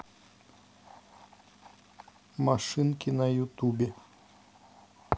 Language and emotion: Russian, neutral